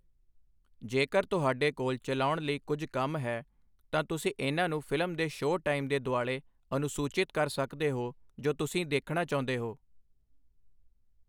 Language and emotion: Punjabi, neutral